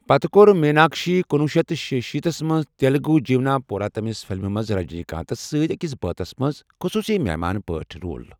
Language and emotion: Kashmiri, neutral